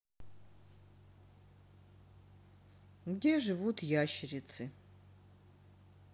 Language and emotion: Russian, neutral